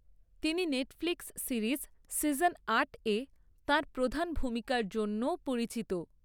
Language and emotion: Bengali, neutral